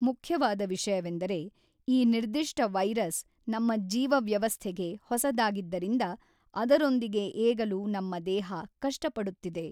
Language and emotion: Kannada, neutral